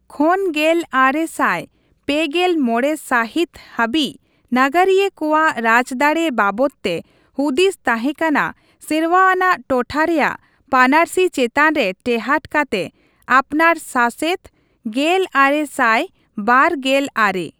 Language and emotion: Santali, neutral